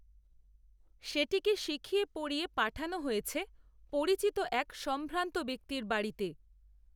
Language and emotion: Bengali, neutral